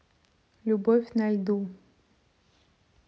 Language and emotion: Russian, neutral